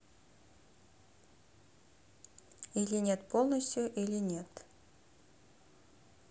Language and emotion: Russian, neutral